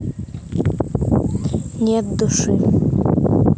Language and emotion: Russian, neutral